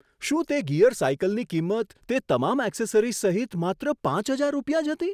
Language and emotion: Gujarati, surprised